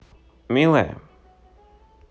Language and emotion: Russian, positive